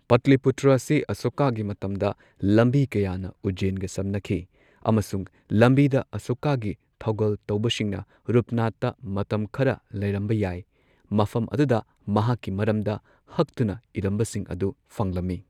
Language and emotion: Manipuri, neutral